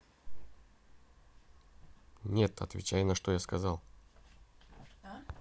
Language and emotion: Russian, neutral